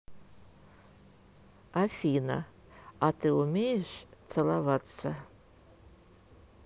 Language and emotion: Russian, neutral